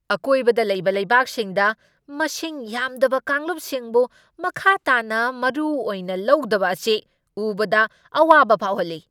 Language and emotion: Manipuri, angry